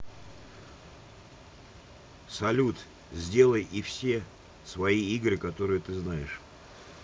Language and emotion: Russian, neutral